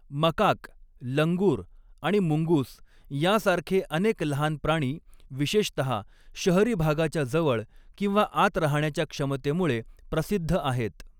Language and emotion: Marathi, neutral